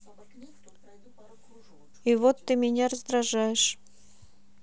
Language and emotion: Russian, neutral